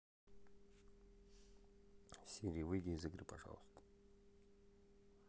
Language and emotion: Russian, neutral